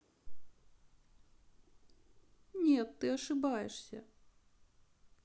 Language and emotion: Russian, sad